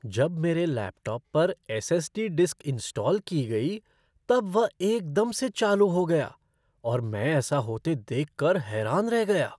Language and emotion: Hindi, surprised